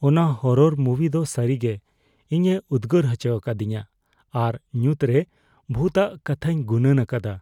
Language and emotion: Santali, fearful